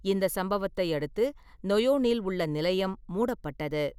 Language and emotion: Tamil, neutral